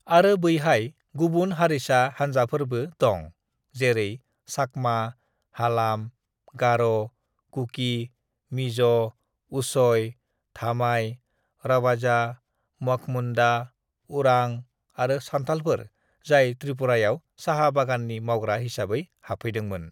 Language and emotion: Bodo, neutral